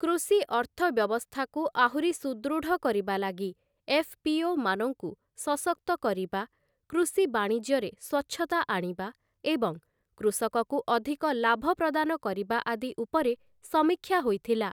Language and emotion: Odia, neutral